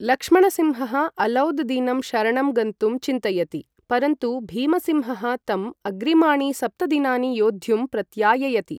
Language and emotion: Sanskrit, neutral